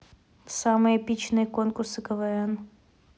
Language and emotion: Russian, neutral